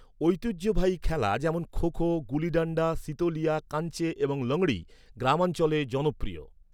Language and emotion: Bengali, neutral